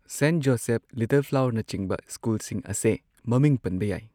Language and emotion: Manipuri, neutral